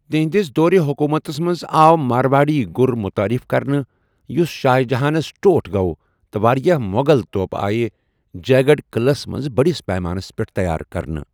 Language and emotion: Kashmiri, neutral